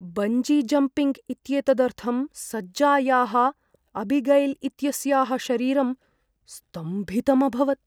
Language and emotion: Sanskrit, fearful